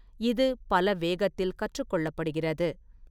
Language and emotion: Tamil, neutral